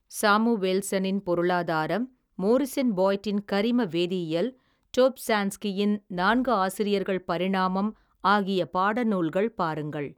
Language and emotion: Tamil, neutral